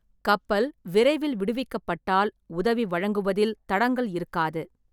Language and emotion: Tamil, neutral